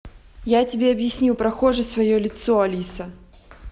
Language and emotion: Russian, angry